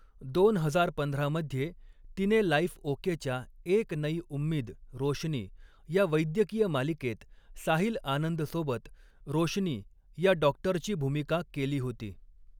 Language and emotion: Marathi, neutral